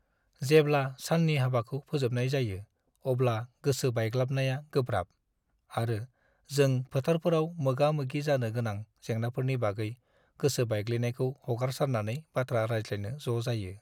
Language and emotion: Bodo, sad